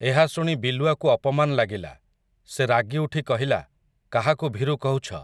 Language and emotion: Odia, neutral